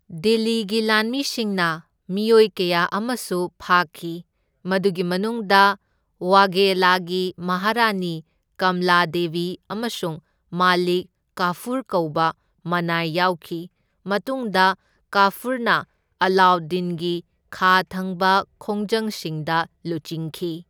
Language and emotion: Manipuri, neutral